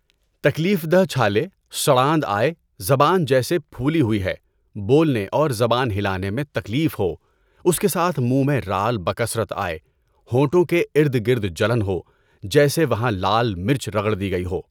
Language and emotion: Urdu, neutral